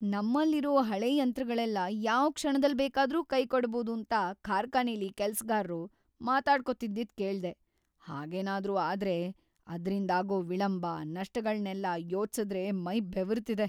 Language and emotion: Kannada, fearful